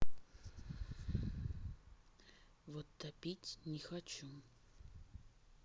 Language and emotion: Russian, neutral